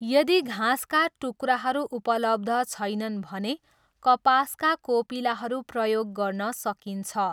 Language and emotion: Nepali, neutral